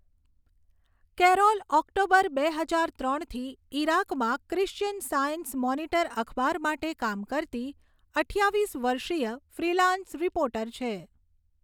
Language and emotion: Gujarati, neutral